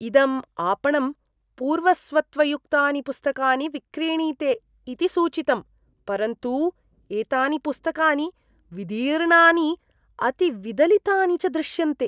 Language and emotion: Sanskrit, disgusted